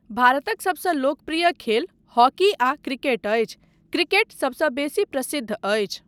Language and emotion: Maithili, neutral